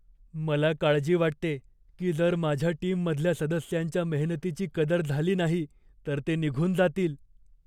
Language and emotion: Marathi, fearful